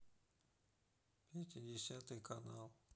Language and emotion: Russian, sad